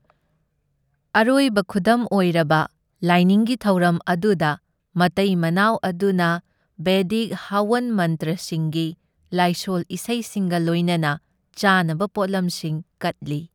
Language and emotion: Manipuri, neutral